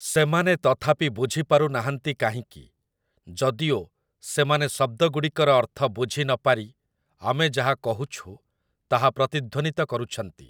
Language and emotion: Odia, neutral